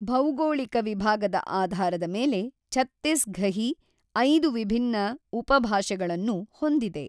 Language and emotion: Kannada, neutral